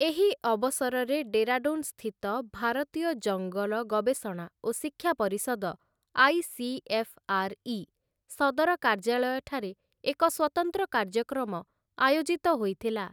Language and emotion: Odia, neutral